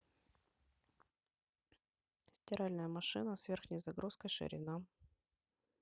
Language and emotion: Russian, neutral